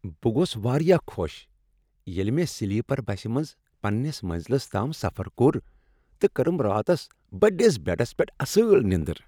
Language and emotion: Kashmiri, happy